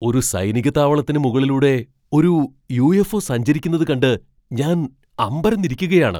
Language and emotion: Malayalam, surprised